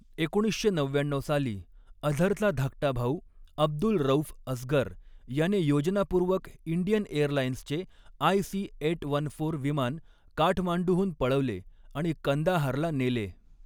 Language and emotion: Marathi, neutral